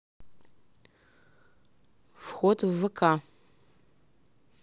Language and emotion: Russian, neutral